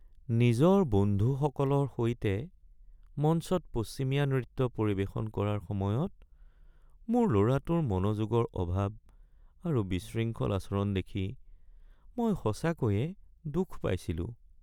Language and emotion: Assamese, sad